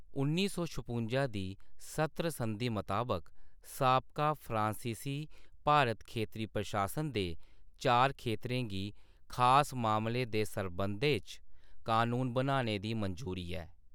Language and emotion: Dogri, neutral